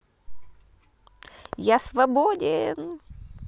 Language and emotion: Russian, positive